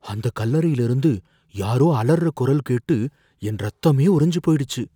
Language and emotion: Tamil, fearful